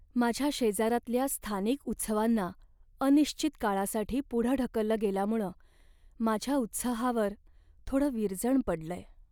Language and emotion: Marathi, sad